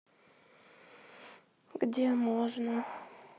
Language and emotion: Russian, sad